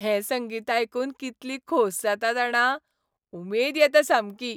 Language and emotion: Goan Konkani, happy